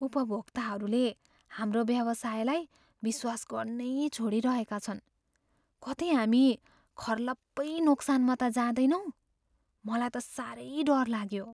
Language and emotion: Nepali, fearful